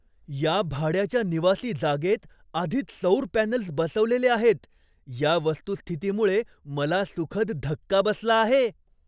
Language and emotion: Marathi, surprised